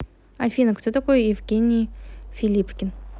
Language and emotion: Russian, neutral